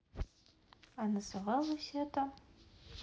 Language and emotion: Russian, neutral